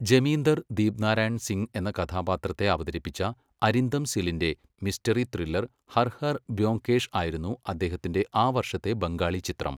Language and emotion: Malayalam, neutral